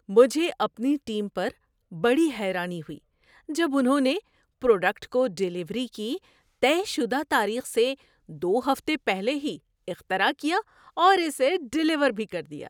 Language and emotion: Urdu, surprised